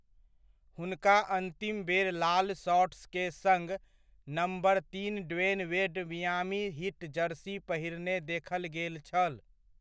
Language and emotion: Maithili, neutral